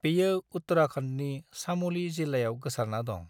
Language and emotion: Bodo, neutral